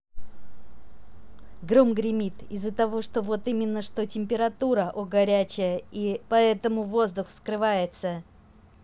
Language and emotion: Russian, positive